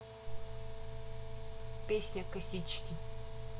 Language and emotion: Russian, neutral